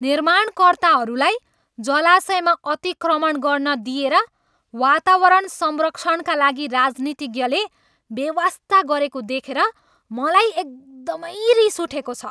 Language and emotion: Nepali, angry